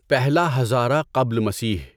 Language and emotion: Urdu, neutral